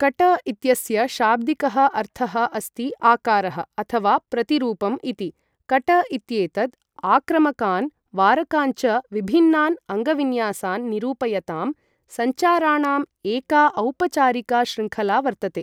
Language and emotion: Sanskrit, neutral